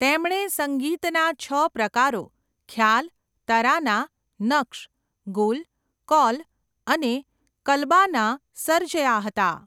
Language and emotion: Gujarati, neutral